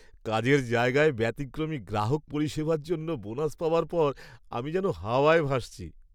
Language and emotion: Bengali, happy